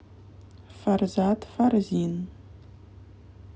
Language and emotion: Russian, neutral